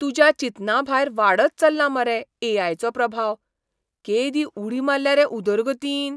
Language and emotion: Goan Konkani, surprised